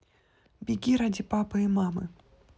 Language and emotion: Russian, neutral